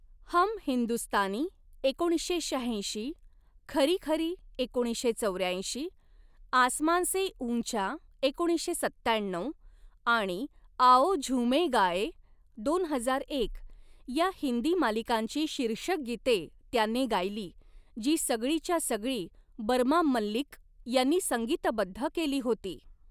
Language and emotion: Marathi, neutral